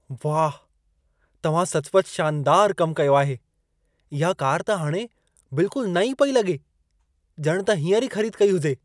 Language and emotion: Sindhi, surprised